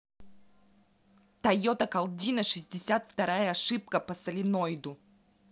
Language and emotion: Russian, angry